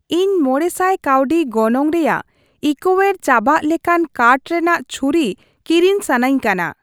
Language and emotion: Santali, neutral